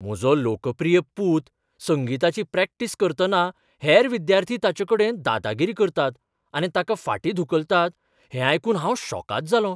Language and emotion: Goan Konkani, surprised